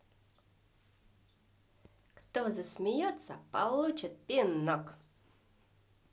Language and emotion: Russian, positive